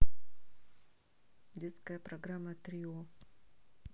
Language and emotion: Russian, neutral